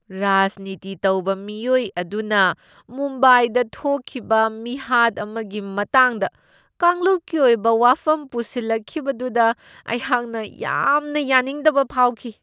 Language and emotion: Manipuri, disgusted